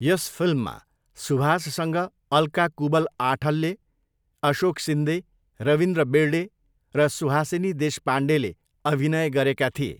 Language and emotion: Nepali, neutral